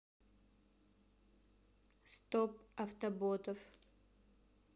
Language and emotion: Russian, neutral